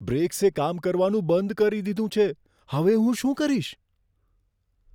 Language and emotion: Gujarati, fearful